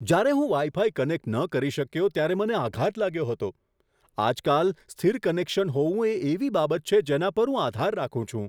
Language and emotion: Gujarati, surprised